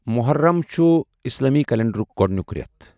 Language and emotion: Kashmiri, neutral